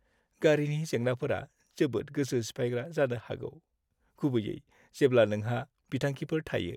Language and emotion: Bodo, sad